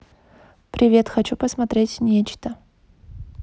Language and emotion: Russian, neutral